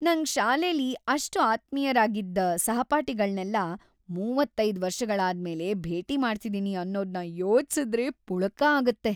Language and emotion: Kannada, happy